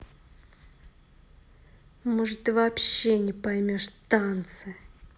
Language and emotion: Russian, angry